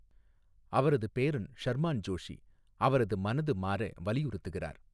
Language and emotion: Tamil, neutral